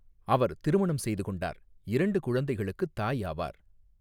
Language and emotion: Tamil, neutral